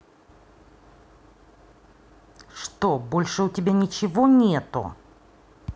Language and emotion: Russian, angry